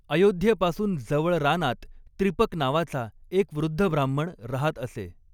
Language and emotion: Marathi, neutral